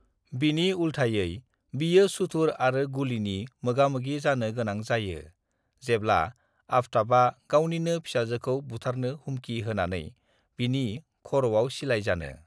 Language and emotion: Bodo, neutral